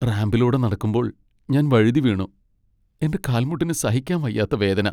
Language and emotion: Malayalam, sad